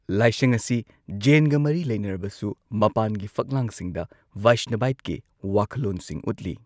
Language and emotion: Manipuri, neutral